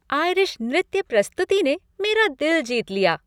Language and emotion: Hindi, happy